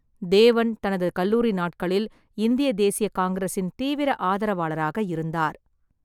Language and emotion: Tamil, neutral